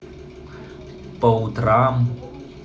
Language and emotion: Russian, neutral